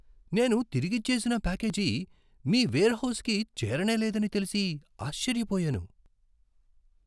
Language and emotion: Telugu, surprised